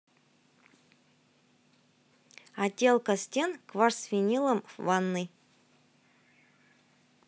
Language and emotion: Russian, neutral